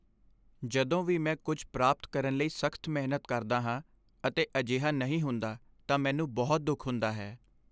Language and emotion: Punjabi, sad